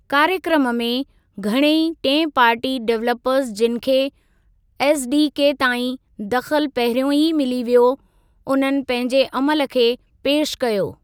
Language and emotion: Sindhi, neutral